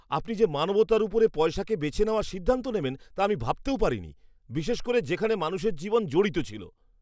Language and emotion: Bengali, disgusted